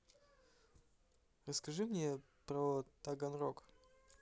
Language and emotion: Russian, neutral